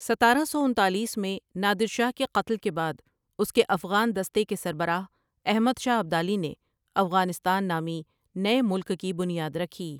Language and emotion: Urdu, neutral